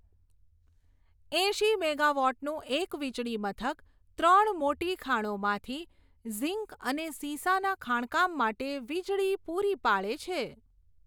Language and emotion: Gujarati, neutral